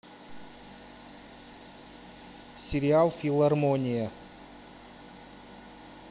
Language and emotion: Russian, neutral